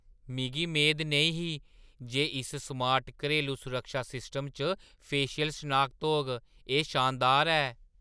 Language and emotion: Dogri, surprised